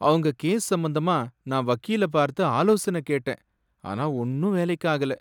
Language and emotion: Tamil, sad